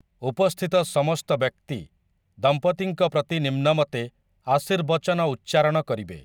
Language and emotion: Odia, neutral